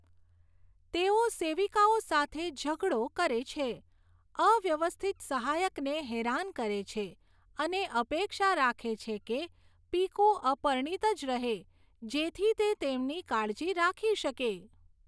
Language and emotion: Gujarati, neutral